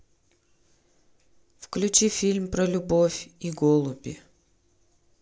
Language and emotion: Russian, neutral